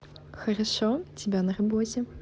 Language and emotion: Russian, positive